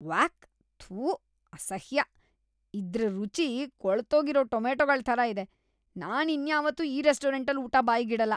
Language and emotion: Kannada, disgusted